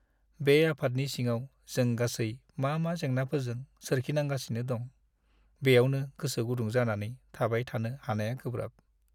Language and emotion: Bodo, sad